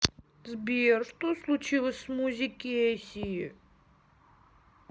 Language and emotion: Russian, sad